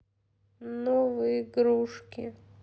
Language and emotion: Russian, sad